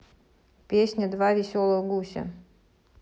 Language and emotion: Russian, neutral